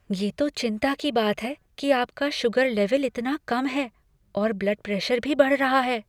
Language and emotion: Hindi, fearful